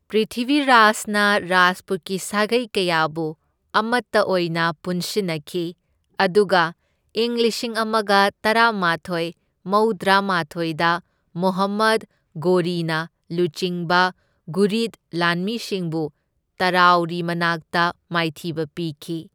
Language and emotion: Manipuri, neutral